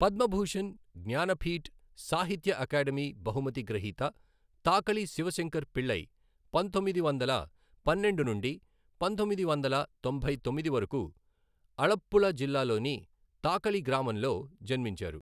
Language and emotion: Telugu, neutral